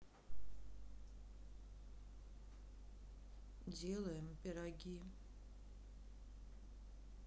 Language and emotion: Russian, sad